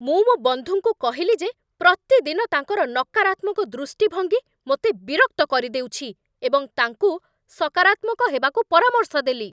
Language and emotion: Odia, angry